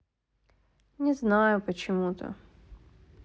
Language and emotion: Russian, sad